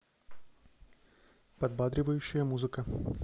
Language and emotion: Russian, neutral